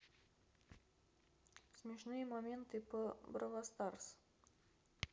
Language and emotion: Russian, neutral